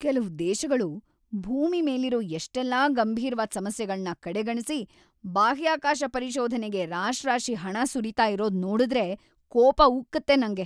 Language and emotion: Kannada, angry